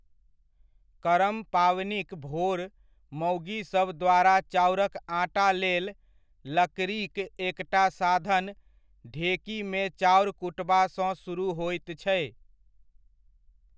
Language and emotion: Maithili, neutral